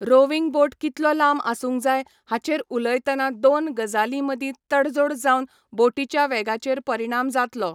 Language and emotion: Goan Konkani, neutral